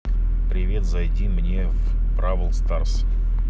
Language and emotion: Russian, neutral